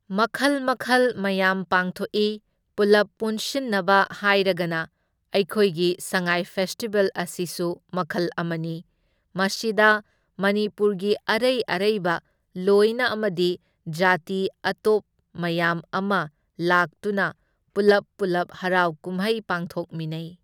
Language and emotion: Manipuri, neutral